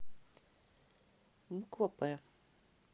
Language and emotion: Russian, neutral